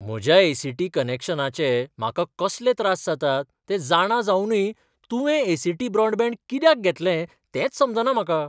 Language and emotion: Goan Konkani, surprised